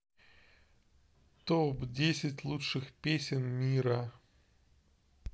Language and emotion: Russian, neutral